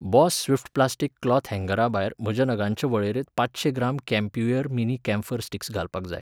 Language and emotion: Goan Konkani, neutral